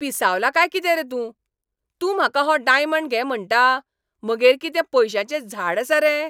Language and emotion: Goan Konkani, angry